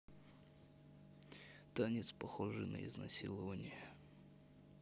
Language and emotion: Russian, neutral